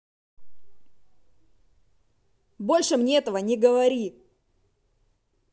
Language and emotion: Russian, angry